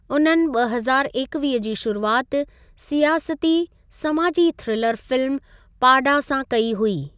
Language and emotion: Sindhi, neutral